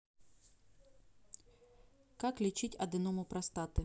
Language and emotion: Russian, neutral